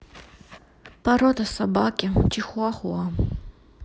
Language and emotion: Russian, sad